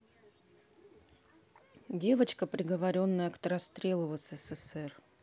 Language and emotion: Russian, neutral